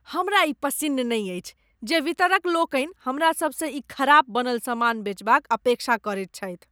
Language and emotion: Maithili, disgusted